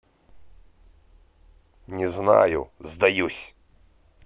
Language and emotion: Russian, angry